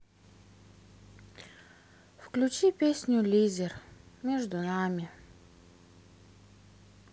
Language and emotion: Russian, sad